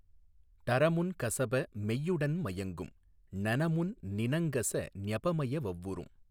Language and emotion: Tamil, neutral